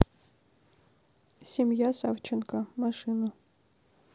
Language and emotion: Russian, neutral